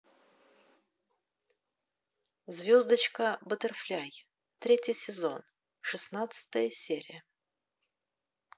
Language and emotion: Russian, neutral